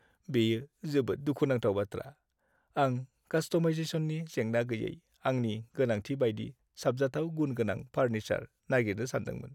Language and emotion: Bodo, sad